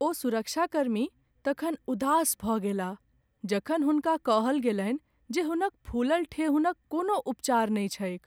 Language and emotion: Maithili, sad